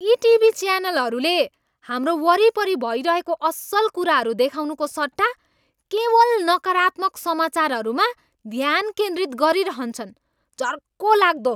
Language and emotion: Nepali, angry